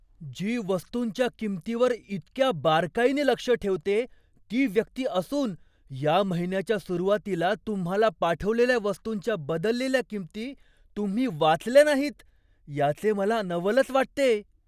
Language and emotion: Marathi, surprised